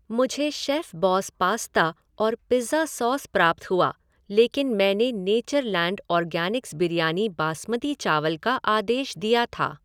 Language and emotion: Hindi, neutral